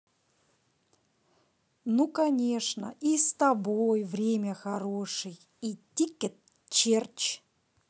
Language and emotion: Russian, positive